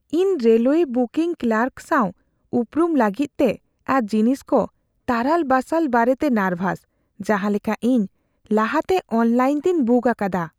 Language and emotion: Santali, fearful